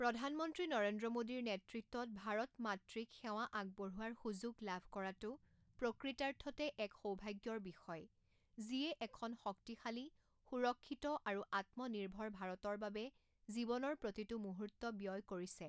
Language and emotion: Assamese, neutral